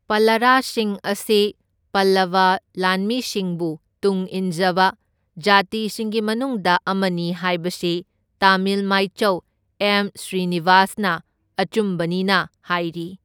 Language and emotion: Manipuri, neutral